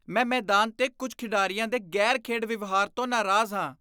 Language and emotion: Punjabi, disgusted